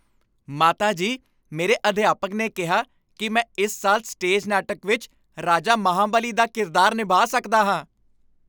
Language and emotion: Punjabi, happy